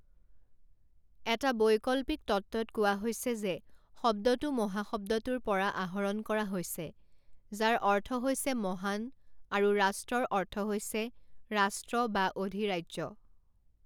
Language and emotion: Assamese, neutral